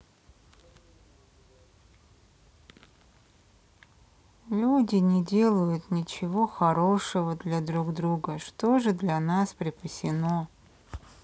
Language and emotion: Russian, sad